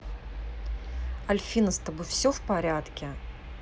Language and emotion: Russian, neutral